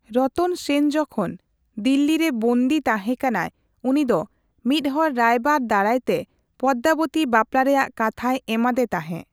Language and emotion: Santali, neutral